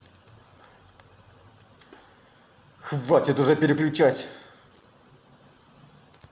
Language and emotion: Russian, angry